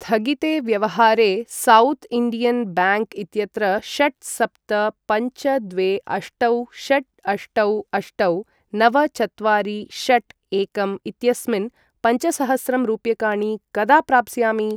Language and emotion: Sanskrit, neutral